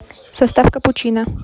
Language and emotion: Russian, neutral